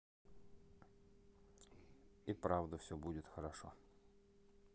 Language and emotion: Russian, neutral